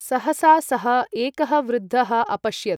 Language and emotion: Sanskrit, neutral